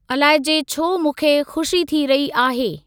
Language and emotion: Sindhi, neutral